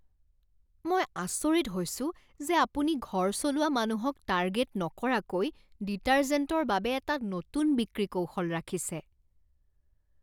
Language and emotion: Assamese, disgusted